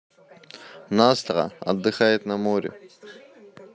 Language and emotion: Russian, neutral